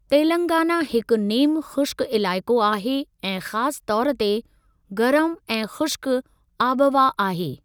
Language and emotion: Sindhi, neutral